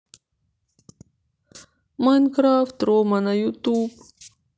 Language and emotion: Russian, sad